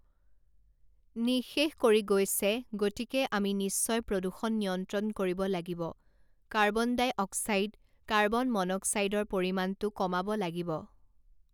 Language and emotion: Assamese, neutral